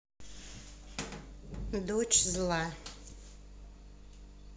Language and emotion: Russian, neutral